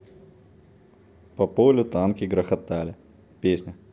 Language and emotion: Russian, neutral